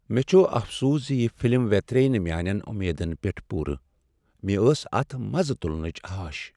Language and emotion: Kashmiri, sad